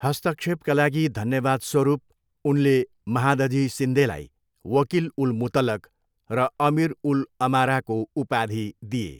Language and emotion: Nepali, neutral